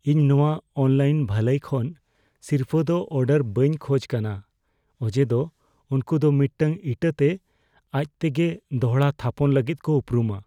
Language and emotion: Santali, fearful